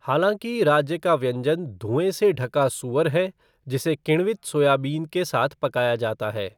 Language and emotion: Hindi, neutral